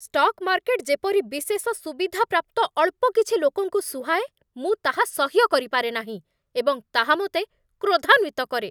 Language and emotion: Odia, angry